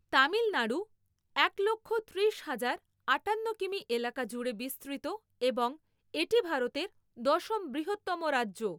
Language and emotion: Bengali, neutral